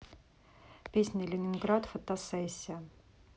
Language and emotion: Russian, neutral